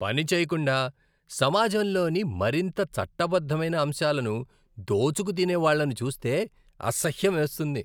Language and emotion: Telugu, disgusted